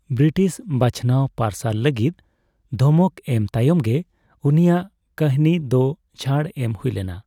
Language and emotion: Santali, neutral